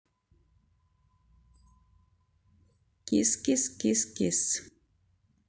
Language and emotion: Russian, neutral